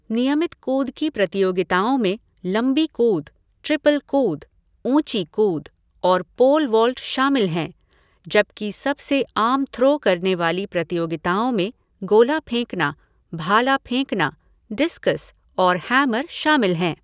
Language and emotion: Hindi, neutral